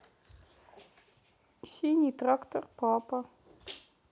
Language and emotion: Russian, neutral